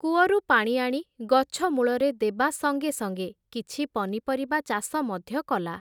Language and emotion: Odia, neutral